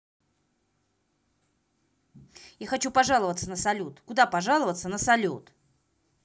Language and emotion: Russian, angry